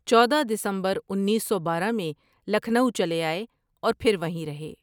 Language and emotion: Urdu, neutral